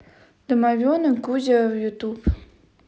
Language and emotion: Russian, neutral